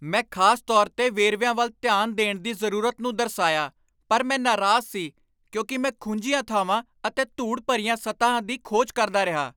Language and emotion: Punjabi, angry